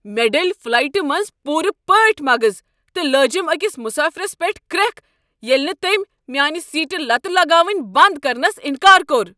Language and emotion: Kashmiri, angry